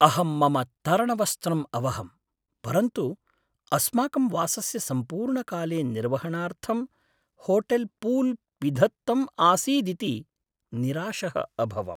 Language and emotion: Sanskrit, sad